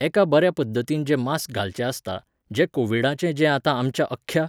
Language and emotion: Goan Konkani, neutral